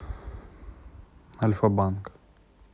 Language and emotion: Russian, neutral